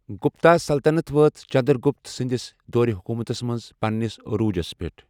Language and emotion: Kashmiri, neutral